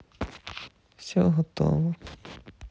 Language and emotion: Russian, sad